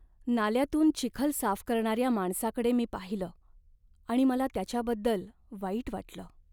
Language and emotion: Marathi, sad